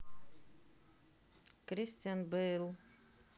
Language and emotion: Russian, neutral